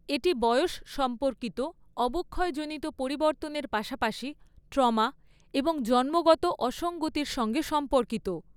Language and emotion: Bengali, neutral